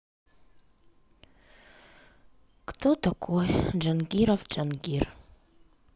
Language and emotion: Russian, sad